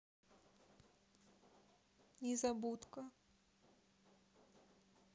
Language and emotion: Russian, sad